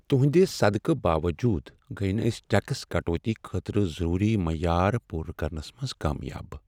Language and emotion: Kashmiri, sad